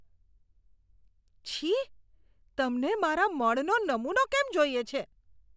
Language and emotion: Gujarati, disgusted